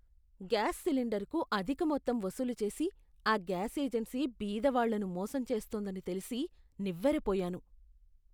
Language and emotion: Telugu, disgusted